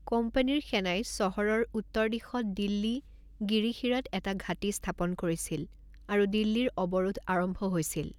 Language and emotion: Assamese, neutral